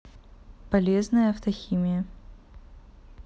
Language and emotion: Russian, neutral